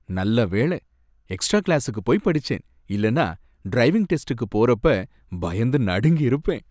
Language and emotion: Tamil, happy